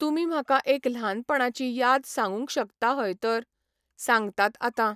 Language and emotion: Goan Konkani, neutral